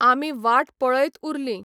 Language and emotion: Goan Konkani, neutral